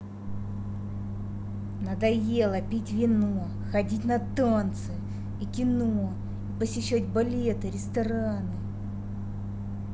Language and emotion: Russian, angry